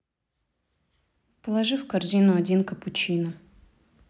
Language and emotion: Russian, neutral